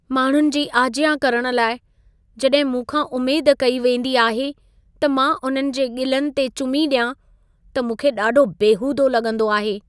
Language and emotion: Sindhi, sad